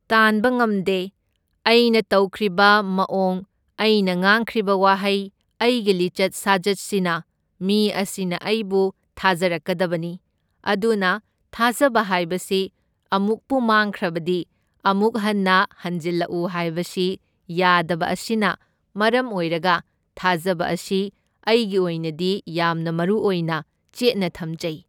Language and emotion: Manipuri, neutral